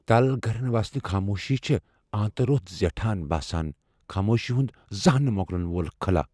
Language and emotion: Kashmiri, fearful